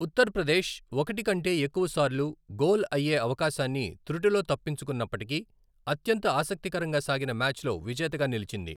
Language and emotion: Telugu, neutral